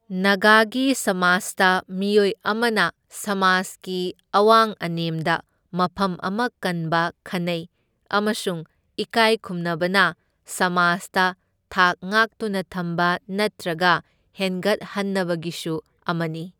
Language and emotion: Manipuri, neutral